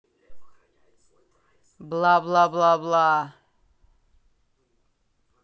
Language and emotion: Russian, neutral